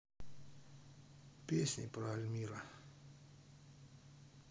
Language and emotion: Russian, neutral